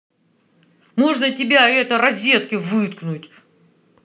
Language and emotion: Russian, angry